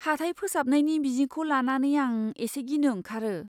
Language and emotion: Bodo, fearful